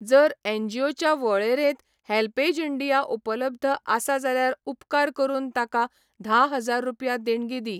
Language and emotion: Goan Konkani, neutral